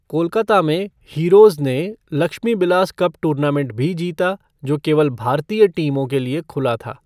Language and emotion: Hindi, neutral